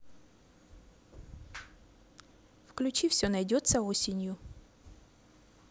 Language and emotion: Russian, neutral